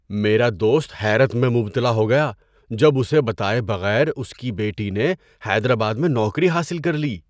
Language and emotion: Urdu, surprised